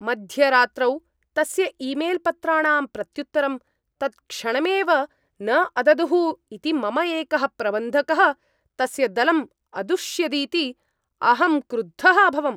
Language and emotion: Sanskrit, angry